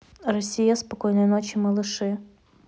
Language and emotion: Russian, neutral